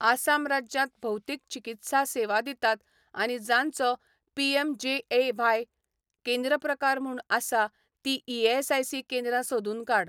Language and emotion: Goan Konkani, neutral